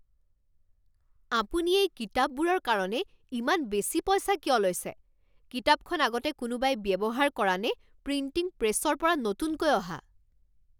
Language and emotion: Assamese, angry